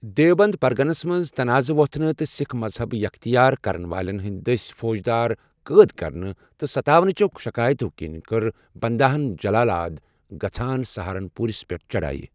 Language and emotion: Kashmiri, neutral